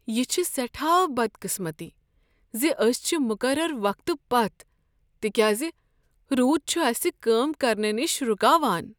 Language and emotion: Kashmiri, sad